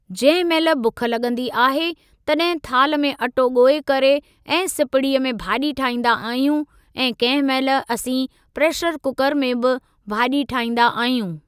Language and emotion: Sindhi, neutral